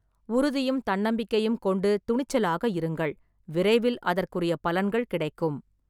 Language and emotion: Tamil, neutral